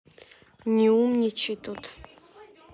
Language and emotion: Russian, neutral